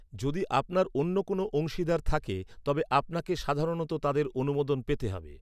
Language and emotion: Bengali, neutral